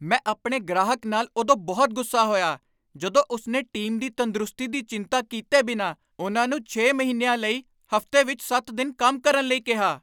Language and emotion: Punjabi, angry